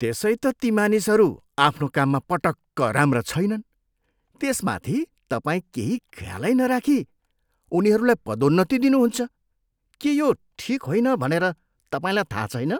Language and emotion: Nepali, disgusted